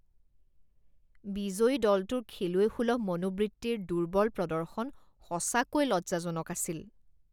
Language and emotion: Assamese, disgusted